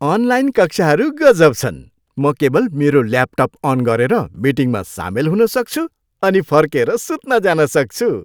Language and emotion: Nepali, happy